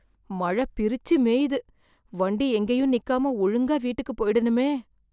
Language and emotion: Tamil, fearful